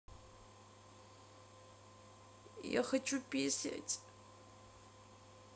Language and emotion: Russian, sad